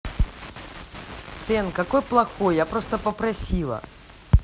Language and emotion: Russian, neutral